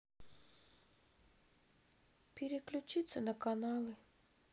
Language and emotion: Russian, sad